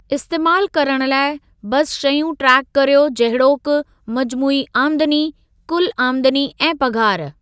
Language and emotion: Sindhi, neutral